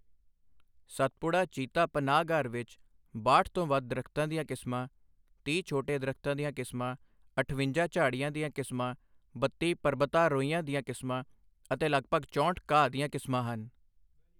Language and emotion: Punjabi, neutral